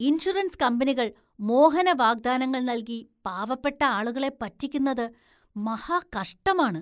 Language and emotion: Malayalam, disgusted